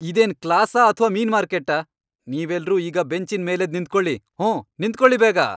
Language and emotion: Kannada, angry